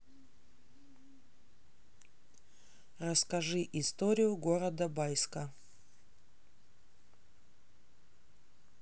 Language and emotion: Russian, neutral